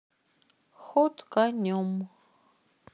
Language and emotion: Russian, neutral